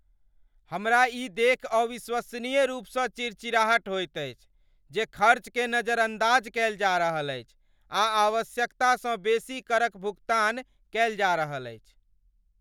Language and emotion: Maithili, angry